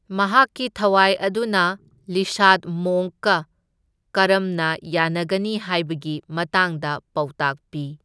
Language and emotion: Manipuri, neutral